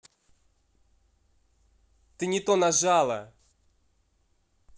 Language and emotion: Russian, angry